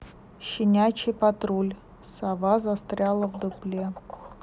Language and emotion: Russian, neutral